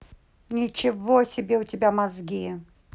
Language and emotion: Russian, angry